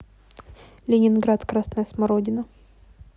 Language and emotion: Russian, neutral